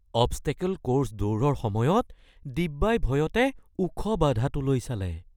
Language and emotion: Assamese, fearful